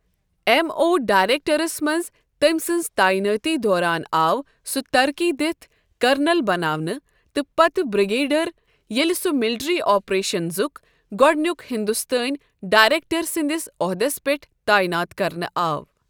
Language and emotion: Kashmiri, neutral